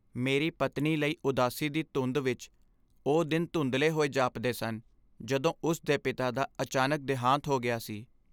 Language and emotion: Punjabi, sad